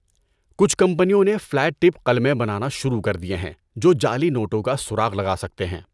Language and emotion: Urdu, neutral